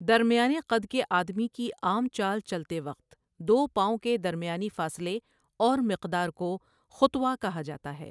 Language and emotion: Urdu, neutral